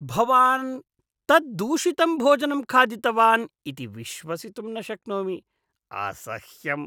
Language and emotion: Sanskrit, disgusted